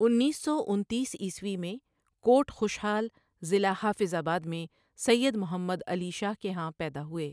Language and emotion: Urdu, neutral